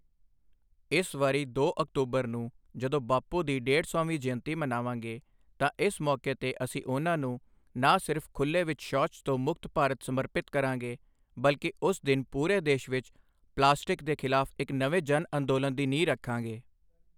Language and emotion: Punjabi, neutral